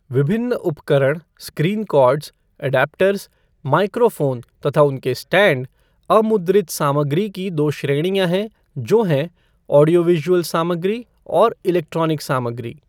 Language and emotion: Hindi, neutral